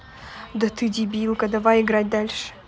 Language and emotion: Russian, angry